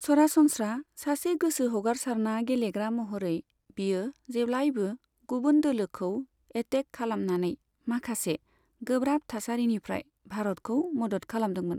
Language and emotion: Bodo, neutral